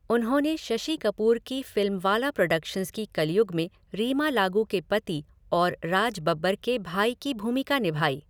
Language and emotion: Hindi, neutral